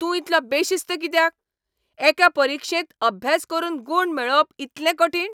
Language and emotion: Goan Konkani, angry